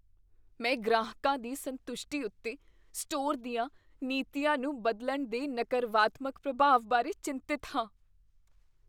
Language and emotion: Punjabi, fearful